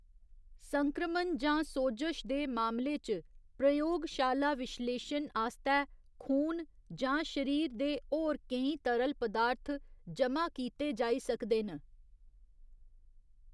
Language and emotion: Dogri, neutral